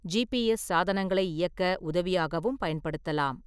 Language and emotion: Tamil, neutral